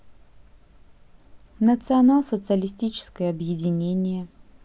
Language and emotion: Russian, neutral